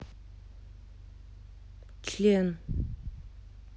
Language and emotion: Russian, neutral